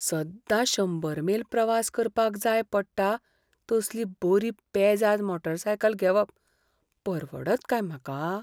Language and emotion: Goan Konkani, fearful